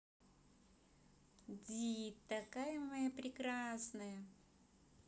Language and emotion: Russian, positive